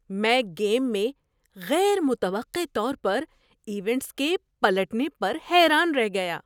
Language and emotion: Urdu, surprised